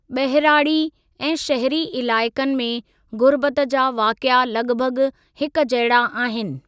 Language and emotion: Sindhi, neutral